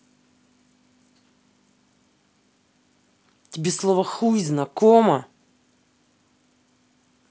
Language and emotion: Russian, angry